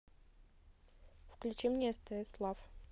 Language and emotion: Russian, neutral